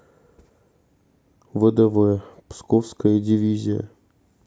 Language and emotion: Russian, sad